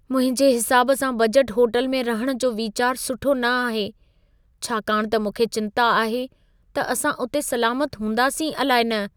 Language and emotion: Sindhi, fearful